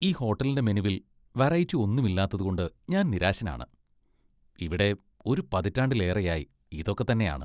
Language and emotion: Malayalam, disgusted